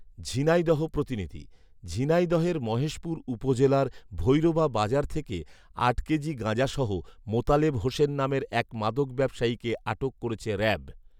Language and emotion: Bengali, neutral